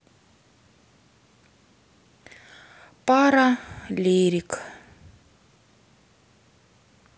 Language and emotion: Russian, sad